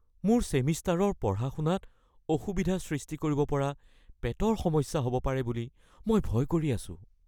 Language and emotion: Assamese, fearful